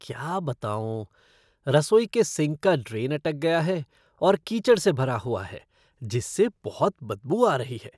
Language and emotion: Hindi, disgusted